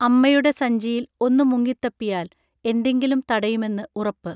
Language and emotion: Malayalam, neutral